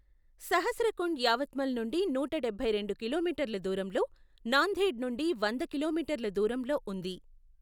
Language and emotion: Telugu, neutral